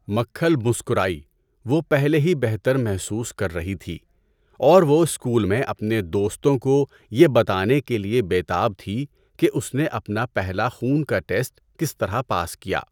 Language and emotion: Urdu, neutral